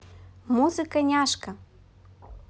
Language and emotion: Russian, positive